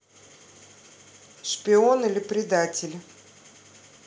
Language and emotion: Russian, neutral